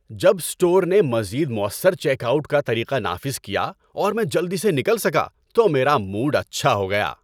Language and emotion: Urdu, happy